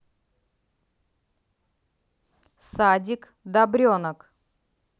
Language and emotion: Russian, neutral